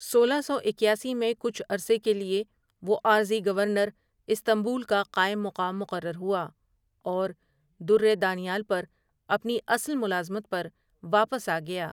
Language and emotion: Urdu, neutral